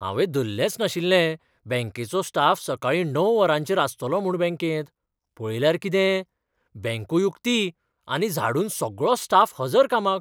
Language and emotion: Goan Konkani, surprised